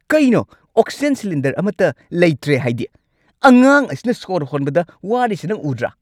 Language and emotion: Manipuri, angry